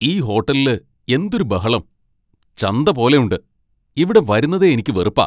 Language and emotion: Malayalam, angry